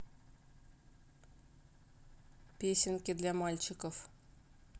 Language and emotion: Russian, neutral